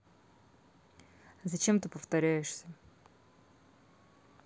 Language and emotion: Russian, neutral